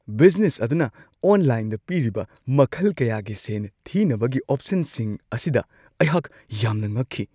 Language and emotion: Manipuri, surprised